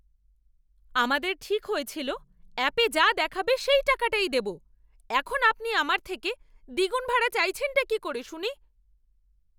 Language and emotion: Bengali, angry